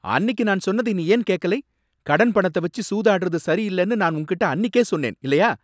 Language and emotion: Tamil, angry